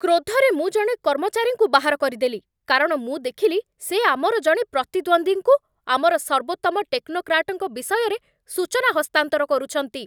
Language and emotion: Odia, angry